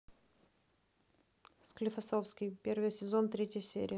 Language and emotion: Russian, neutral